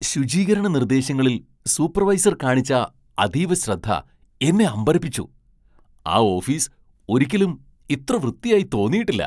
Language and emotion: Malayalam, surprised